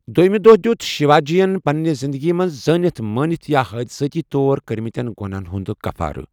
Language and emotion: Kashmiri, neutral